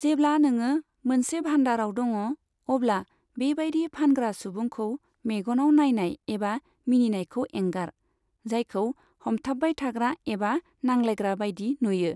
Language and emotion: Bodo, neutral